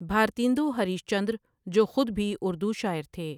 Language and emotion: Urdu, neutral